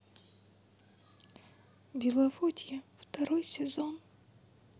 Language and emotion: Russian, sad